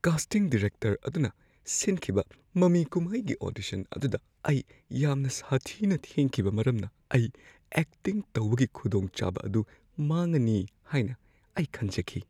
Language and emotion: Manipuri, fearful